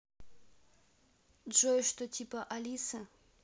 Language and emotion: Russian, neutral